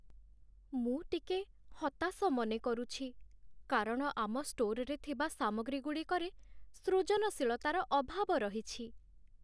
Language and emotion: Odia, sad